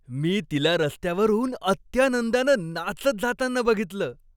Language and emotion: Marathi, happy